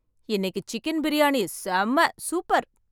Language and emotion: Tamil, happy